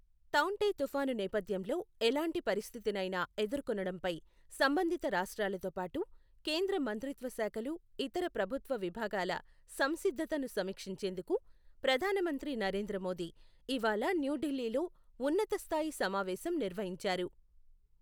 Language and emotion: Telugu, neutral